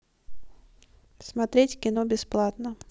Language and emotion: Russian, neutral